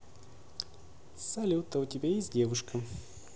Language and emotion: Russian, neutral